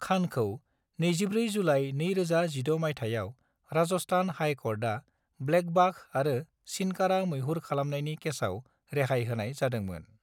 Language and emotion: Bodo, neutral